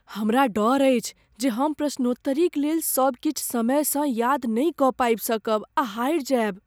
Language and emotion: Maithili, fearful